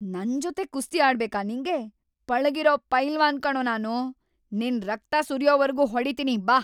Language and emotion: Kannada, angry